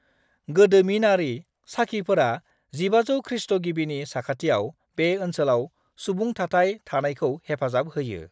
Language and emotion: Bodo, neutral